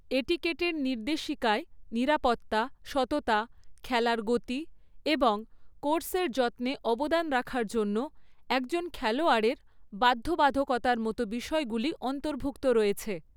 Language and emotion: Bengali, neutral